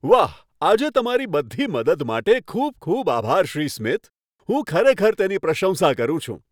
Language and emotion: Gujarati, happy